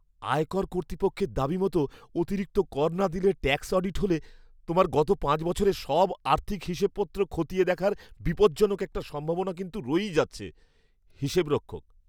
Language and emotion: Bengali, fearful